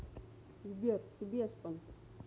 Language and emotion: Russian, neutral